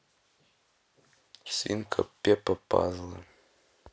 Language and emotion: Russian, neutral